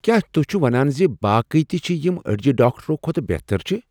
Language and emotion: Kashmiri, surprised